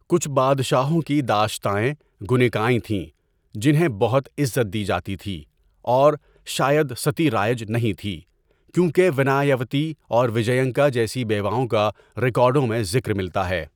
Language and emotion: Urdu, neutral